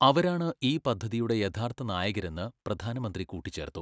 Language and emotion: Malayalam, neutral